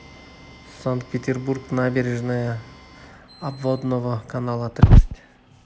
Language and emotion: Russian, neutral